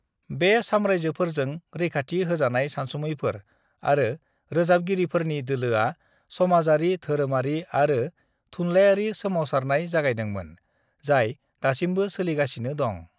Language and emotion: Bodo, neutral